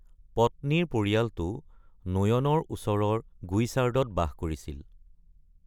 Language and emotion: Assamese, neutral